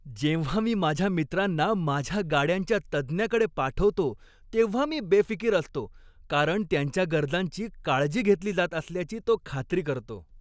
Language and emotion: Marathi, happy